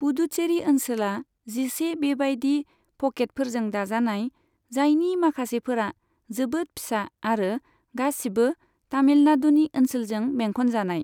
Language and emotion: Bodo, neutral